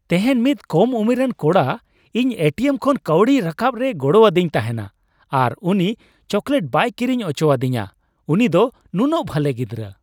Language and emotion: Santali, happy